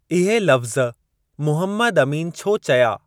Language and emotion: Sindhi, neutral